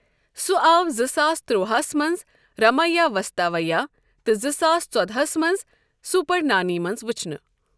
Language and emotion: Kashmiri, neutral